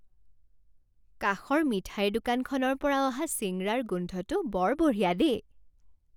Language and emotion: Assamese, happy